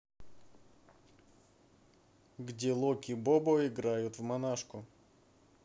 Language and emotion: Russian, neutral